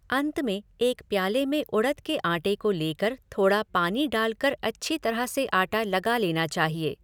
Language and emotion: Hindi, neutral